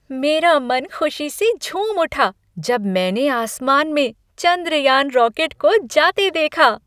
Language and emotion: Hindi, happy